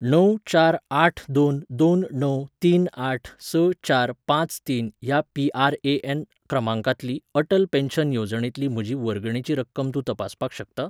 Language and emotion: Goan Konkani, neutral